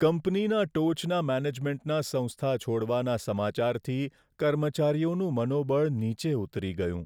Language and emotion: Gujarati, sad